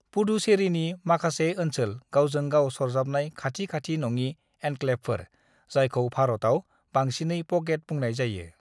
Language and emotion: Bodo, neutral